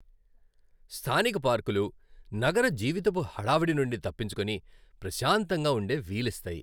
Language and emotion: Telugu, happy